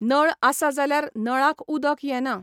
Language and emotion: Goan Konkani, neutral